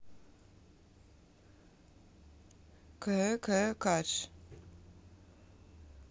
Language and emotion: Russian, neutral